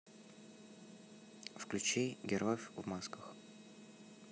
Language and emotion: Russian, neutral